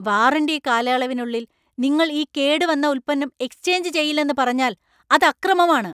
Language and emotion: Malayalam, angry